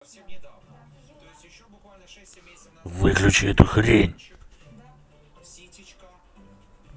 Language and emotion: Russian, angry